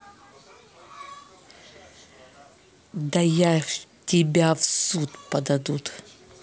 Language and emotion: Russian, angry